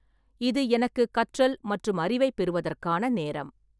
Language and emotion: Tamil, neutral